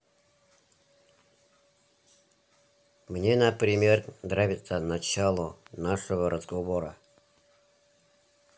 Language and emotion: Russian, neutral